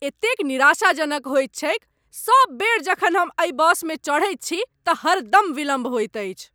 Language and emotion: Maithili, angry